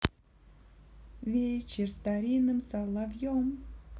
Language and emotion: Russian, positive